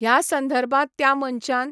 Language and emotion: Goan Konkani, neutral